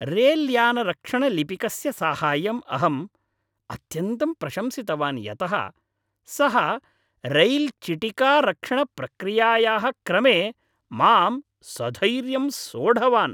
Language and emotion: Sanskrit, happy